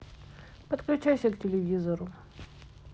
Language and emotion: Russian, neutral